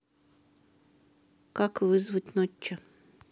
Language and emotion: Russian, neutral